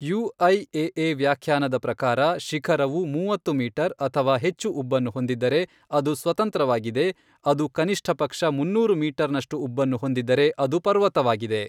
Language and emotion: Kannada, neutral